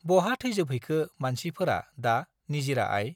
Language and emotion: Bodo, neutral